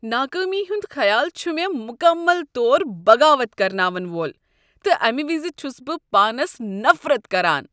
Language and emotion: Kashmiri, disgusted